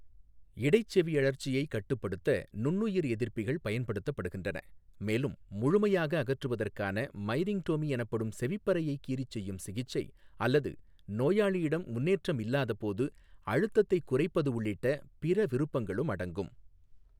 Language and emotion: Tamil, neutral